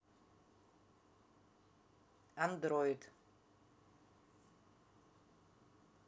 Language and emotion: Russian, neutral